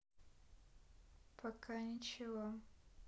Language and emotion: Russian, neutral